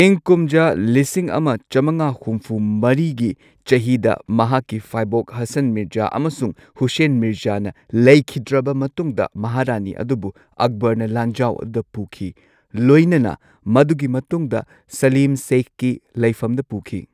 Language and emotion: Manipuri, neutral